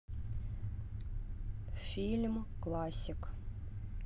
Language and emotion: Russian, neutral